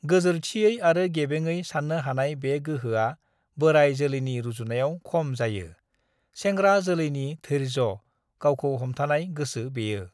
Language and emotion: Bodo, neutral